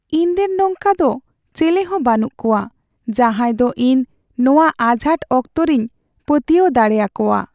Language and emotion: Santali, sad